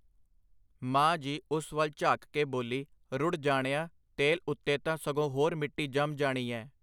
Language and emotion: Punjabi, neutral